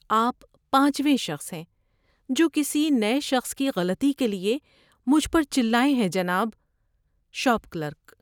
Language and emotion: Urdu, sad